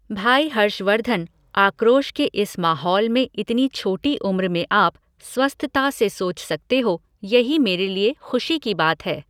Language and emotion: Hindi, neutral